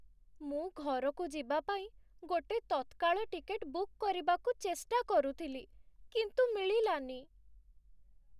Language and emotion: Odia, sad